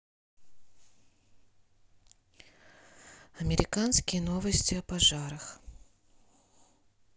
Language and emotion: Russian, sad